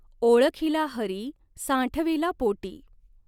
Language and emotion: Marathi, neutral